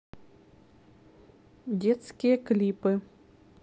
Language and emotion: Russian, neutral